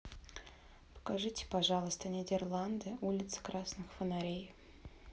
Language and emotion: Russian, neutral